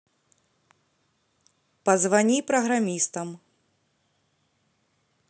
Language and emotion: Russian, neutral